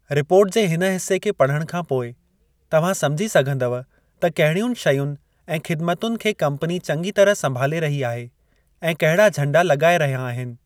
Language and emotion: Sindhi, neutral